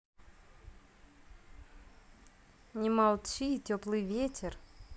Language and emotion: Russian, neutral